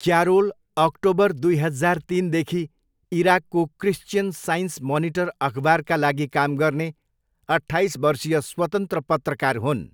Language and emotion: Nepali, neutral